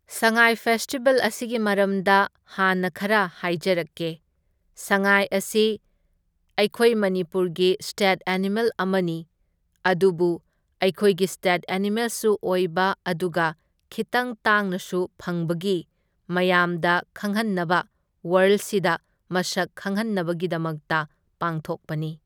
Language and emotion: Manipuri, neutral